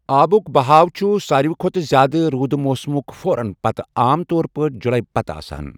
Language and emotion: Kashmiri, neutral